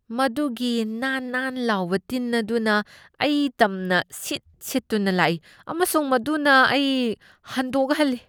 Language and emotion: Manipuri, disgusted